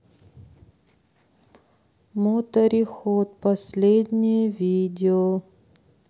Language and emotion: Russian, neutral